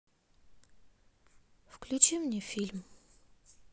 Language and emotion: Russian, sad